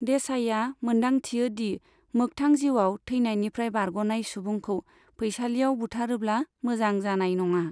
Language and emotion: Bodo, neutral